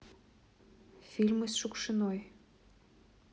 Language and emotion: Russian, neutral